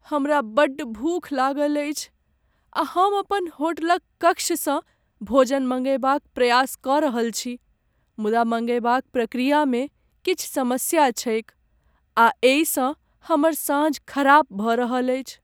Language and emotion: Maithili, sad